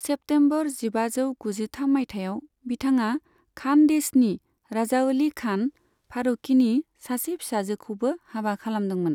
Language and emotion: Bodo, neutral